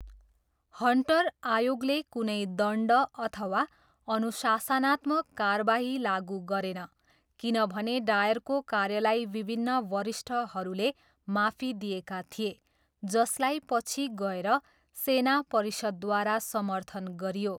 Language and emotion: Nepali, neutral